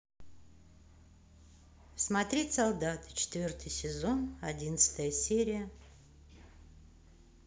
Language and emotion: Russian, neutral